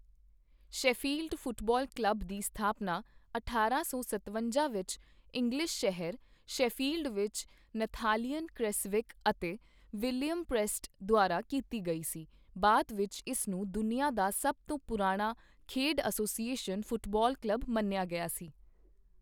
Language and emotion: Punjabi, neutral